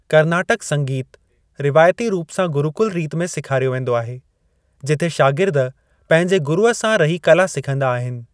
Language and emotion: Sindhi, neutral